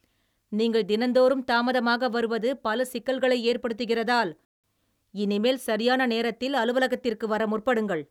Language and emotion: Tamil, angry